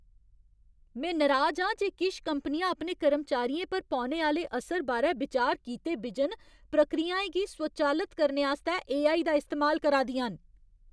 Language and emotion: Dogri, angry